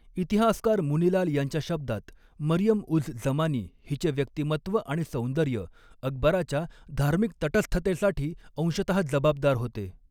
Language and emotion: Marathi, neutral